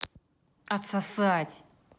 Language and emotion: Russian, angry